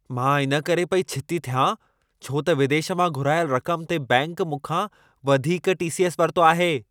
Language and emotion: Sindhi, angry